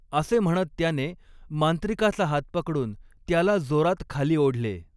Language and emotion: Marathi, neutral